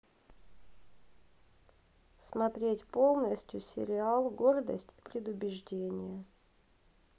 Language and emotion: Russian, neutral